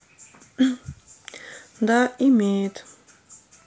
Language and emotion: Russian, neutral